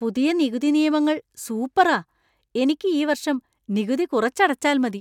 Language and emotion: Malayalam, surprised